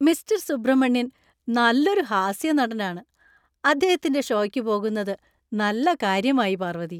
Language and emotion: Malayalam, happy